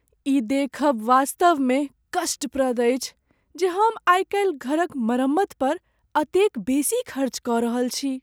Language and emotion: Maithili, sad